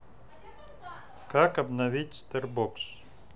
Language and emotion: Russian, neutral